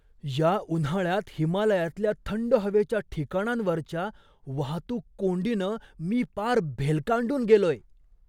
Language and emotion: Marathi, surprised